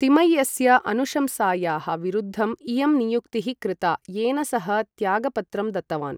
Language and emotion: Sanskrit, neutral